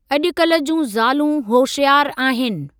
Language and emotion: Sindhi, neutral